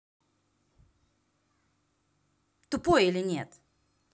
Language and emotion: Russian, angry